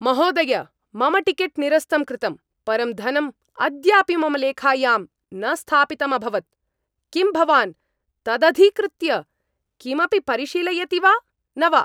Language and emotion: Sanskrit, angry